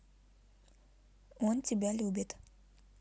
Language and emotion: Russian, neutral